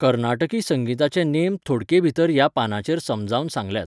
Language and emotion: Goan Konkani, neutral